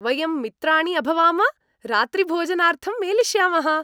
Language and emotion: Sanskrit, happy